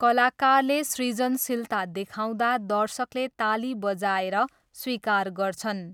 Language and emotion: Nepali, neutral